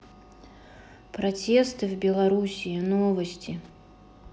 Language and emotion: Russian, neutral